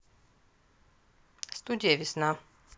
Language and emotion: Russian, neutral